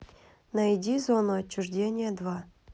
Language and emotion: Russian, neutral